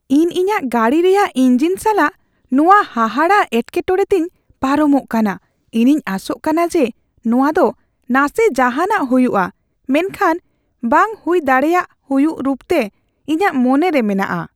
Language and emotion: Santali, fearful